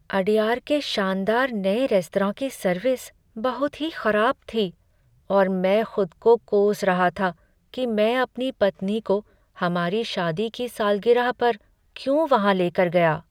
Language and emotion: Hindi, sad